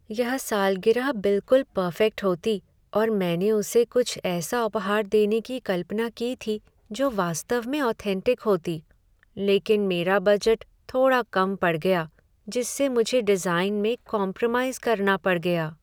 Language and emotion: Hindi, sad